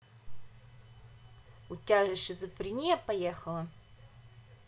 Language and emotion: Russian, angry